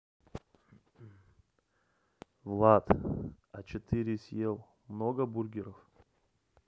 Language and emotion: Russian, neutral